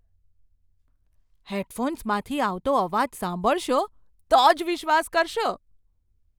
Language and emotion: Gujarati, surprised